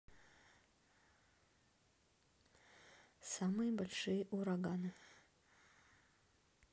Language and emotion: Russian, neutral